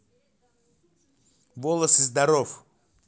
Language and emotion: Russian, neutral